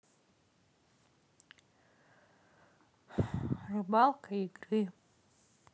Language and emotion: Russian, neutral